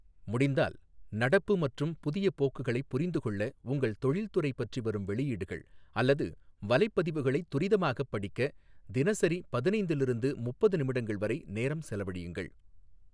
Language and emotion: Tamil, neutral